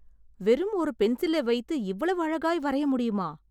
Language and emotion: Tamil, surprised